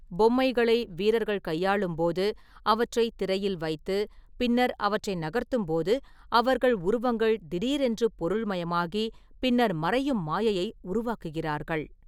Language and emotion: Tamil, neutral